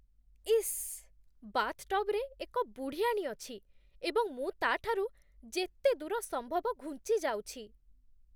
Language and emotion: Odia, disgusted